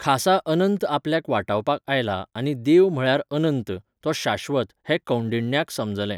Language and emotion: Goan Konkani, neutral